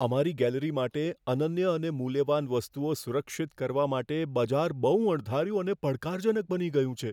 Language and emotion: Gujarati, fearful